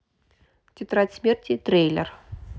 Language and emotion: Russian, neutral